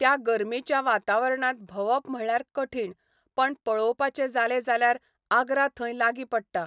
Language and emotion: Goan Konkani, neutral